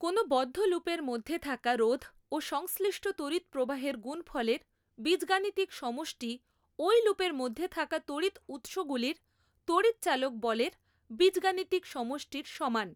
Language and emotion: Bengali, neutral